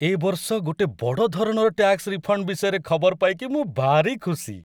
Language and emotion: Odia, happy